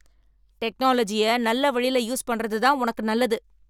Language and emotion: Tamil, angry